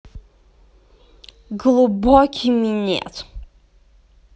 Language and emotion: Russian, positive